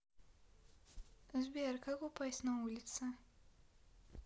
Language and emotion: Russian, neutral